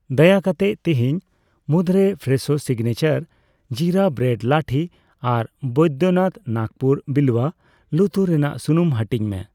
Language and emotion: Santali, neutral